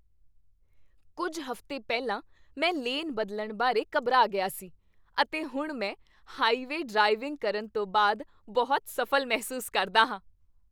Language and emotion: Punjabi, happy